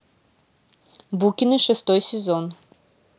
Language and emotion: Russian, neutral